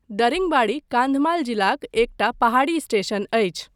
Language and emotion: Maithili, neutral